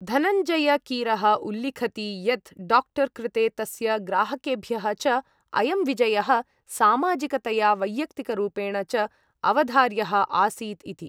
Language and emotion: Sanskrit, neutral